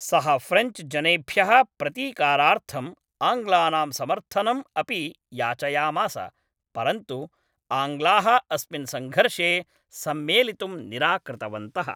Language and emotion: Sanskrit, neutral